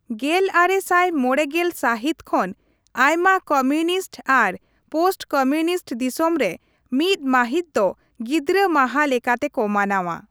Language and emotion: Santali, neutral